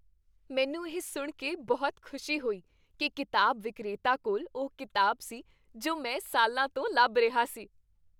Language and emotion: Punjabi, happy